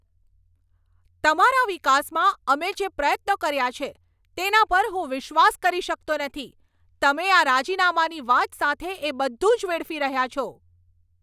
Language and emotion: Gujarati, angry